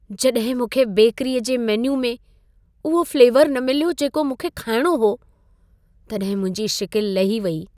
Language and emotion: Sindhi, sad